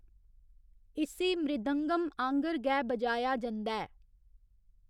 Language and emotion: Dogri, neutral